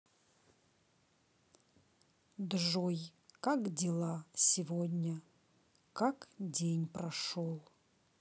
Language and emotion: Russian, neutral